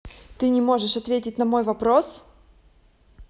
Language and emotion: Russian, angry